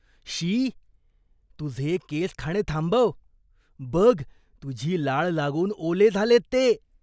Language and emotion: Marathi, disgusted